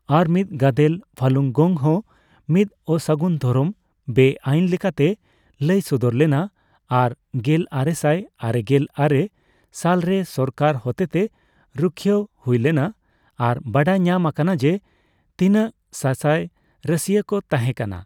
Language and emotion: Santali, neutral